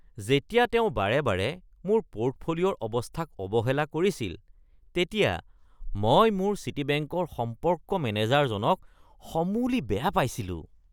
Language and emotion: Assamese, disgusted